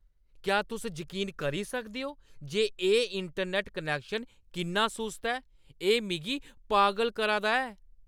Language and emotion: Dogri, angry